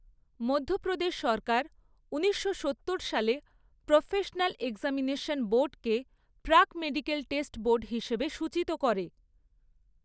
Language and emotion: Bengali, neutral